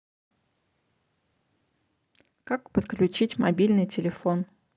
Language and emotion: Russian, neutral